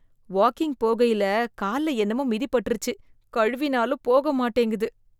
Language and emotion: Tamil, disgusted